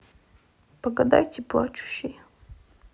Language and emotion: Russian, sad